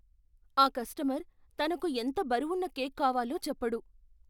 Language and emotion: Telugu, fearful